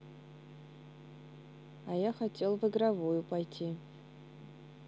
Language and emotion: Russian, neutral